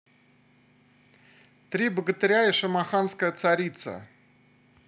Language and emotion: Russian, positive